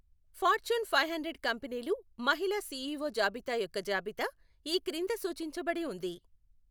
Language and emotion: Telugu, neutral